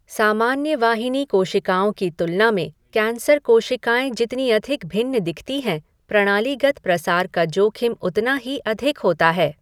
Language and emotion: Hindi, neutral